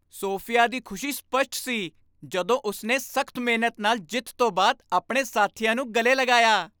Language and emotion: Punjabi, happy